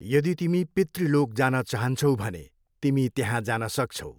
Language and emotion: Nepali, neutral